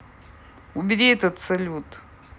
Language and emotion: Russian, angry